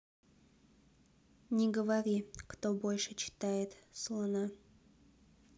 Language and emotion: Russian, neutral